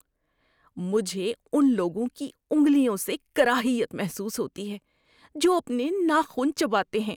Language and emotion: Urdu, disgusted